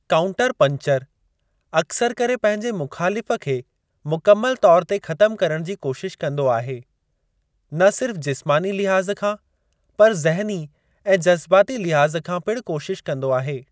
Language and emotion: Sindhi, neutral